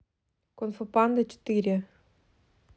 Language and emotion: Russian, neutral